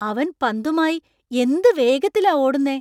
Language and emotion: Malayalam, surprised